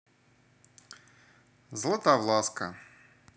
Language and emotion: Russian, neutral